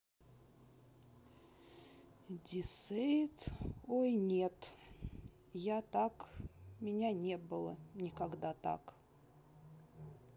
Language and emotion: Russian, sad